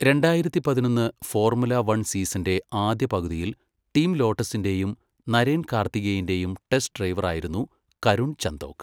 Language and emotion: Malayalam, neutral